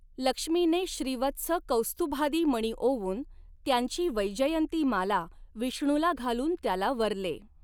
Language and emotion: Marathi, neutral